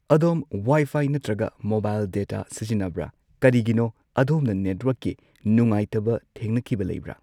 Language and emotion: Manipuri, neutral